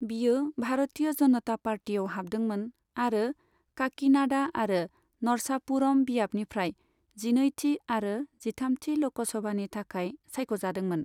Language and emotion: Bodo, neutral